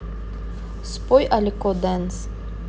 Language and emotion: Russian, neutral